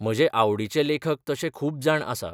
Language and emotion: Goan Konkani, neutral